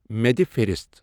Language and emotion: Kashmiri, neutral